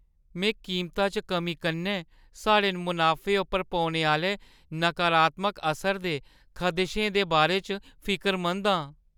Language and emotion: Dogri, fearful